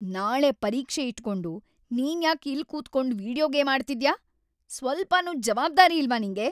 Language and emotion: Kannada, angry